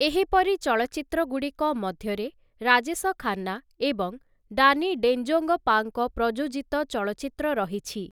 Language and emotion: Odia, neutral